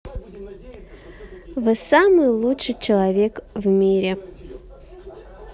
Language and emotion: Russian, positive